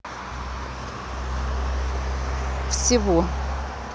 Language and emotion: Russian, neutral